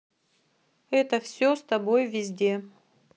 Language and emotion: Russian, neutral